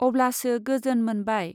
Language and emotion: Bodo, neutral